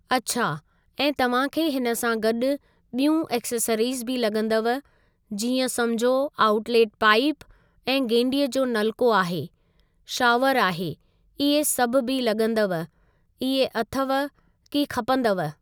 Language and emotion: Sindhi, neutral